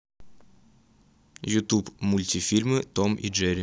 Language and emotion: Russian, neutral